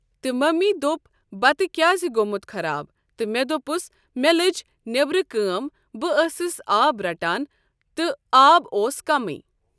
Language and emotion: Kashmiri, neutral